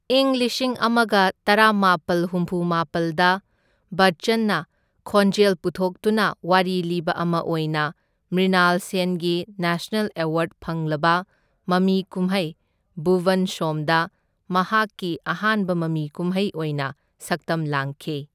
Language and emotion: Manipuri, neutral